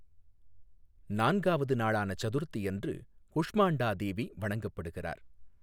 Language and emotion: Tamil, neutral